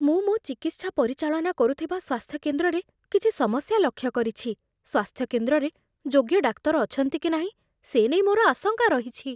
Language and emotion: Odia, fearful